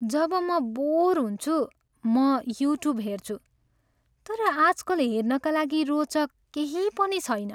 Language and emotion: Nepali, sad